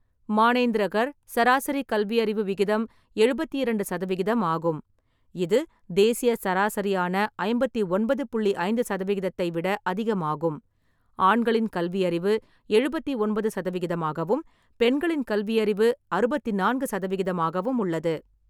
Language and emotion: Tamil, neutral